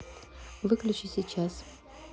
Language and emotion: Russian, neutral